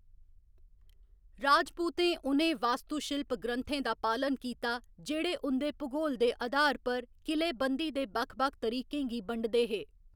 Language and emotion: Dogri, neutral